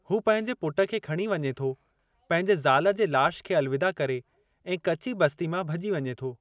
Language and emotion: Sindhi, neutral